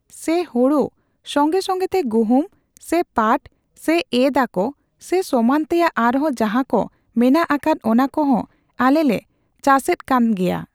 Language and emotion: Santali, neutral